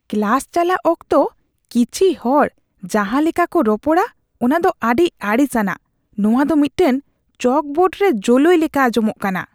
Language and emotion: Santali, disgusted